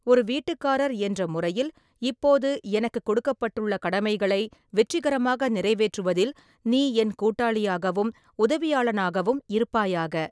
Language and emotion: Tamil, neutral